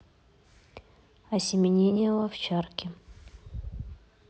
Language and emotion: Russian, neutral